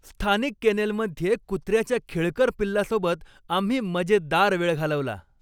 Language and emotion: Marathi, happy